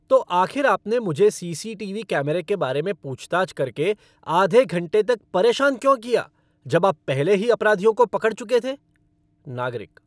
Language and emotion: Hindi, angry